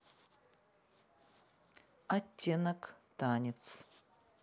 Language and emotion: Russian, neutral